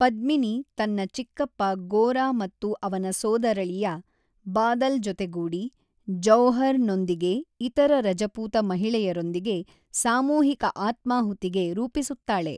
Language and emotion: Kannada, neutral